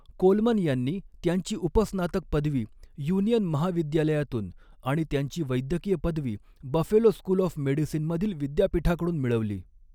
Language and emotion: Marathi, neutral